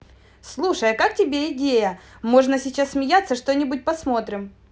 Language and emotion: Russian, positive